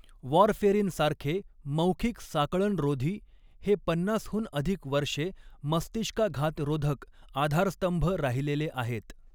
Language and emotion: Marathi, neutral